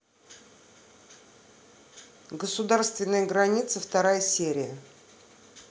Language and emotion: Russian, neutral